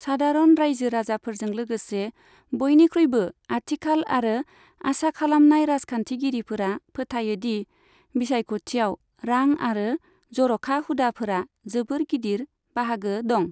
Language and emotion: Bodo, neutral